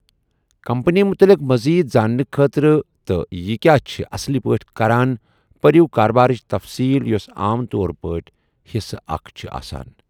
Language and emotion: Kashmiri, neutral